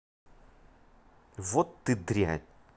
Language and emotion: Russian, angry